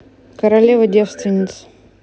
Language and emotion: Russian, neutral